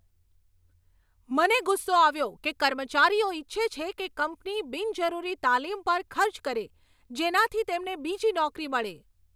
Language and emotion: Gujarati, angry